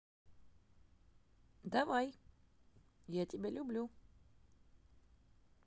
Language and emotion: Russian, positive